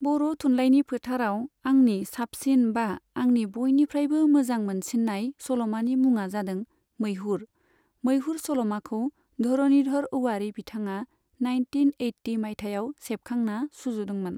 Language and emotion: Bodo, neutral